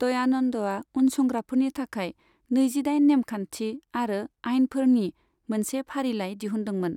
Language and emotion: Bodo, neutral